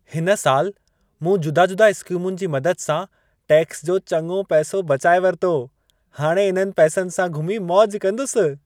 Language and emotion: Sindhi, happy